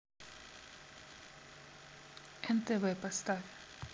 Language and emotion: Russian, neutral